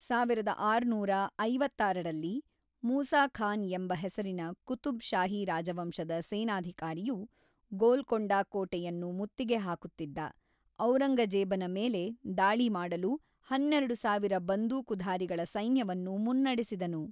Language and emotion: Kannada, neutral